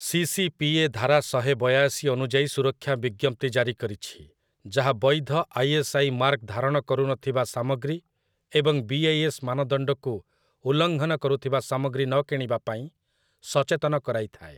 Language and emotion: Odia, neutral